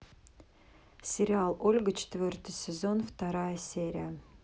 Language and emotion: Russian, neutral